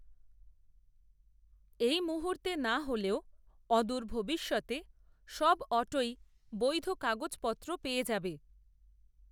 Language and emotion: Bengali, neutral